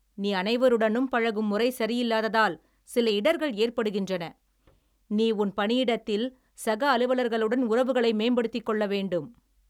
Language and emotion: Tamil, angry